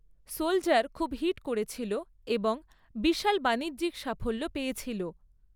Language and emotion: Bengali, neutral